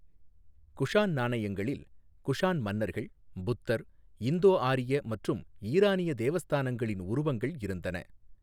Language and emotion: Tamil, neutral